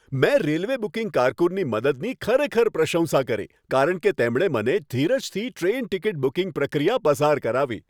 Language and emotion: Gujarati, happy